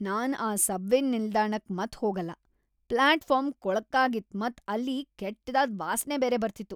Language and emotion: Kannada, disgusted